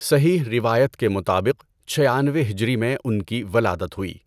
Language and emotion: Urdu, neutral